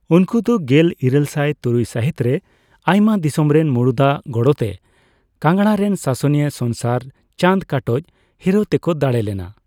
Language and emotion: Santali, neutral